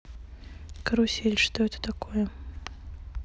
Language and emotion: Russian, neutral